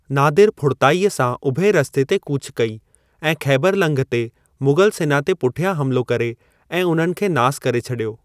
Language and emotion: Sindhi, neutral